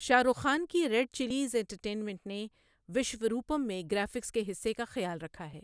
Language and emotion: Urdu, neutral